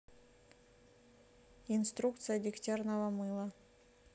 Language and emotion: Russian, neutral